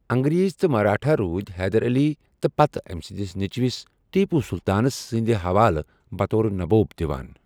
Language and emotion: Kashmiri, neutral